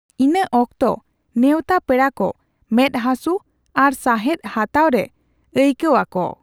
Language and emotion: Santali, neutral